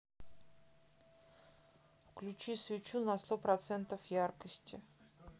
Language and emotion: Russian, neutral